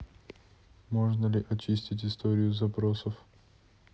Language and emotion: Russian, neutral